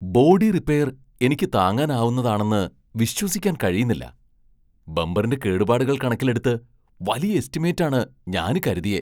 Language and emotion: Malayalam, surprised